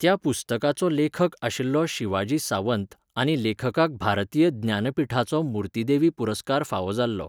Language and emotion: Goan Konkani, neutral